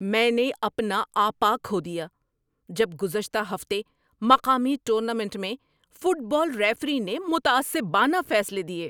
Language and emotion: Urdu, angry